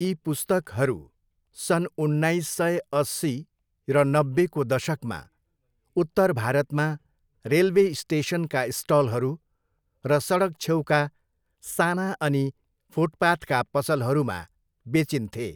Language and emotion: Nepali, neutral